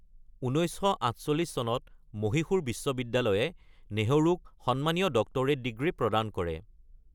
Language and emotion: Assamese, neutral